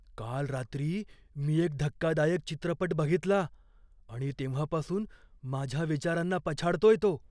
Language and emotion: Marathi, fearful